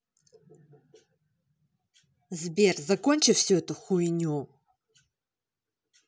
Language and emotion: Russian, angry